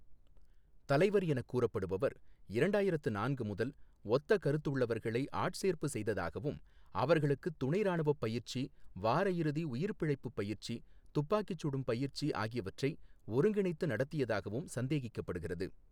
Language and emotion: Tamil, neutral